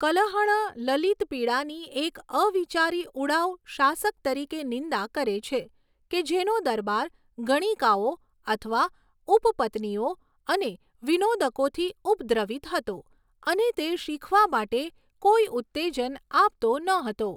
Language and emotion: Gujarati, neutral